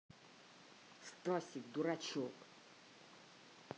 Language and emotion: Russian, angry